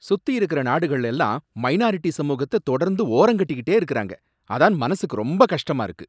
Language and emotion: Tamil, angry